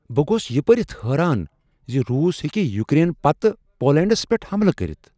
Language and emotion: Kashmiri, surprised